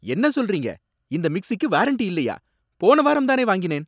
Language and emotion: Tamil, angry